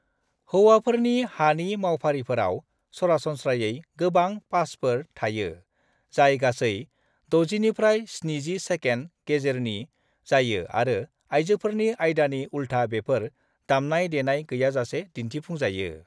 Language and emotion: Bodo, neutral